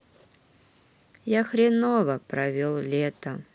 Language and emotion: Russian, neutral